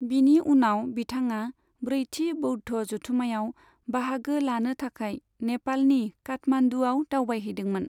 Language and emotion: Bodo, neutral